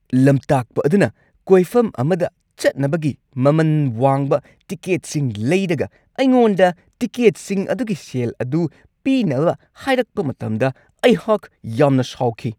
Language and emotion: Manipuri, angry